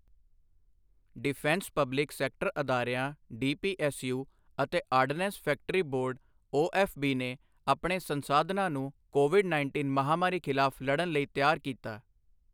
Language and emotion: Punjabi, neutral